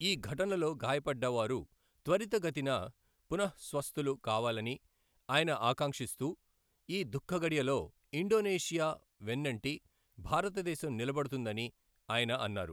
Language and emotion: Telugu, neutral